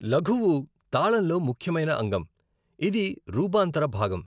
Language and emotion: Telugu, neutral